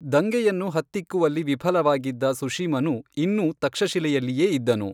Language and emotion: Kannada, neutral